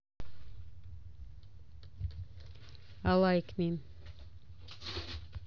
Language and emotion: Russian, neutral